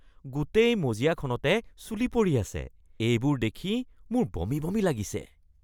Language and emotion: Assamese, disgusted